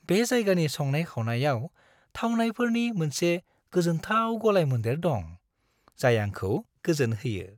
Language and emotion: Bodo, happy